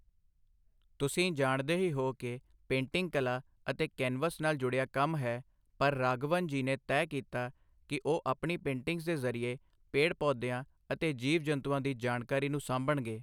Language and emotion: Punjabi, neutral